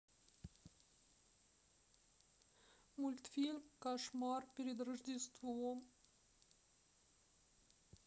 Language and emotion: Russian, sad